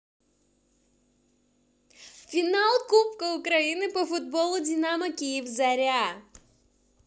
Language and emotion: Russian, positive